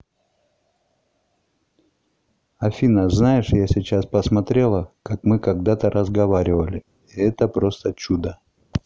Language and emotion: Russian, neutral